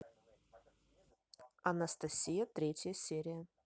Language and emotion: Russian, neutral